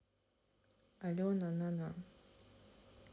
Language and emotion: Russian, neutral